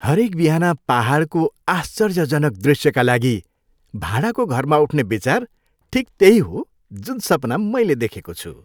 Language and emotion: Nepali, happy